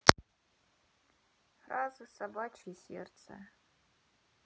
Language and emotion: Russian, neutral